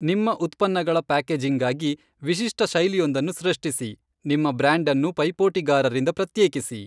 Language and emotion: Kannada, neutral